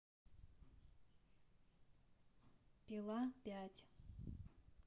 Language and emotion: Russian, neutral